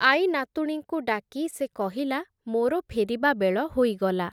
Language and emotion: Odia, neutral